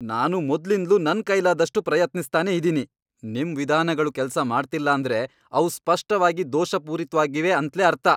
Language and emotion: Kannada, angry